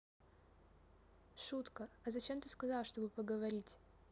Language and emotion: Russian, neutral